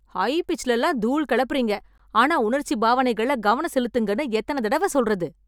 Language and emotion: Tamil, angry